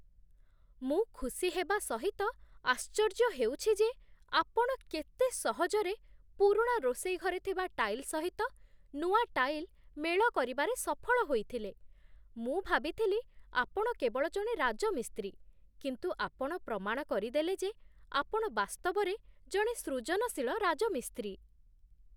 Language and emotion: Odia, surprised